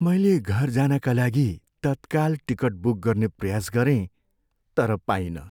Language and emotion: Nepali, sad